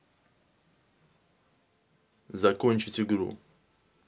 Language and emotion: Russian, neutral